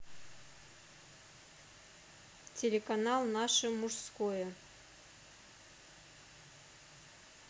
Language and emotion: Russian, neutral